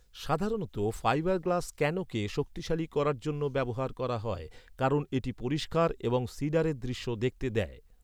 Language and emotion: Bengali, neutral